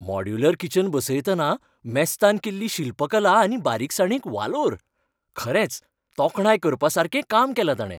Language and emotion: Goan Konkani, happy